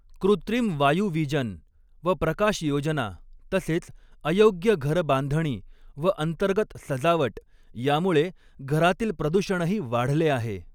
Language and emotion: Marathi, neutral